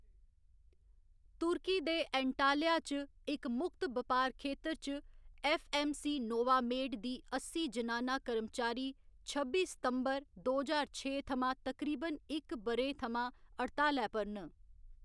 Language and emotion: Dogri, neutral